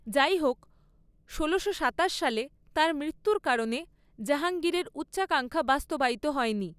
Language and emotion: Bengali, neutral